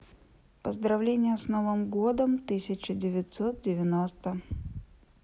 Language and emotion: Russian, neutral